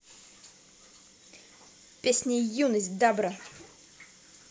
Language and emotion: Russian, positive